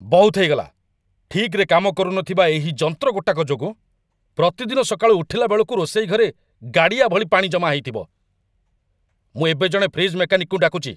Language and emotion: Odia, angry